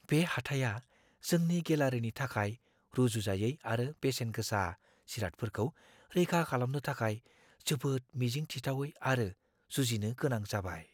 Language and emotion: Bodo, fearful